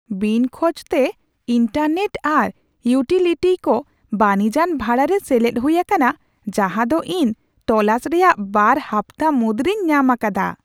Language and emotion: Santali, surprised